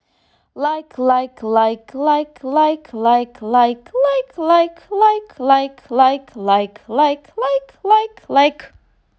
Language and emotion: Russian, positive